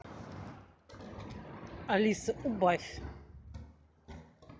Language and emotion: Russian, neutral